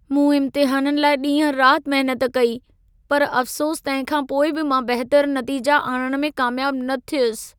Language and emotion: Sindhi, sad